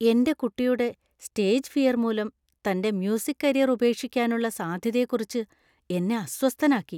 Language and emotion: Malayalam, fearful